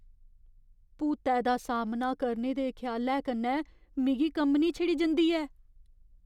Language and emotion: Dogri, fearful